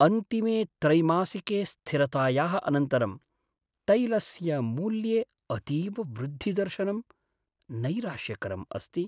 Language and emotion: Sanskrit, sad